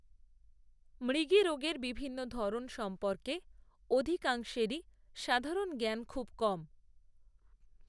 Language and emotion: Bengali, neutral